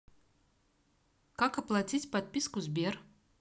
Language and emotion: Russian, neutral